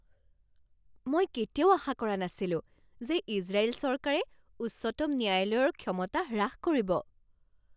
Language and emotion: Assamese, surprised